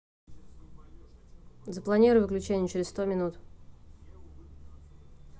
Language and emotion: Russian, neutral